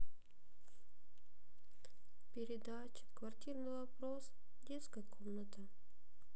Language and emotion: Russian, sad